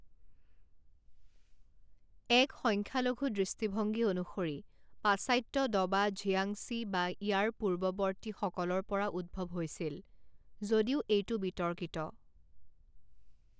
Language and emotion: Assamese, neutral